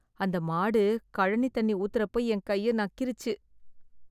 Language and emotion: Tamil, disgusted